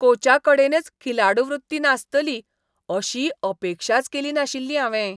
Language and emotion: Goan Konkani, disgusted